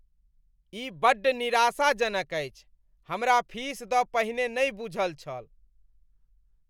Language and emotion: Maithili, disgusted